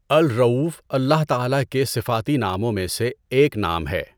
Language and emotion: Urdu, neutral